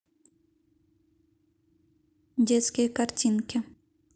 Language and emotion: Russian, neutral